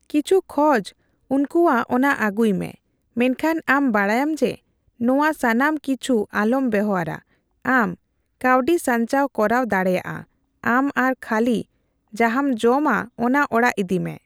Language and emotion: Santali, neutral